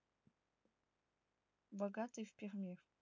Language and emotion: Russian, neutral